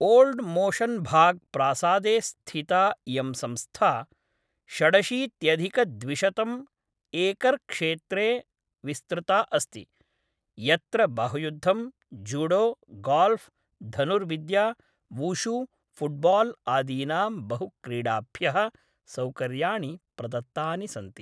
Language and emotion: Sanskrit, neutral